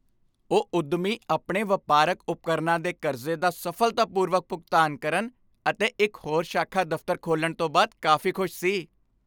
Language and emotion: Punjabi, happy